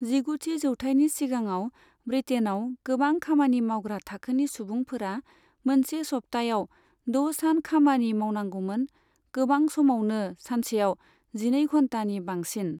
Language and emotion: Bodo, neutral